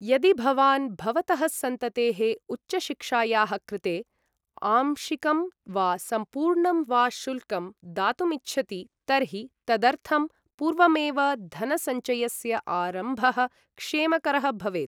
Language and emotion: Sanskrit, neutral